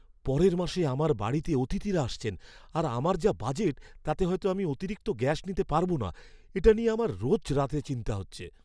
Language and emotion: Bengali, fearful